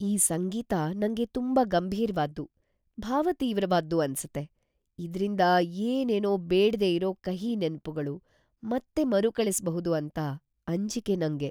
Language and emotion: Kannada, fearful